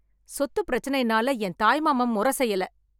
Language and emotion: Tamil, angry